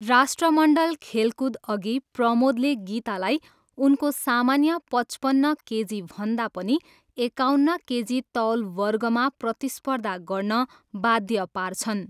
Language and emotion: Nepali, neutral